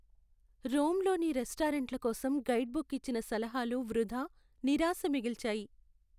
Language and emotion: Telugu, sad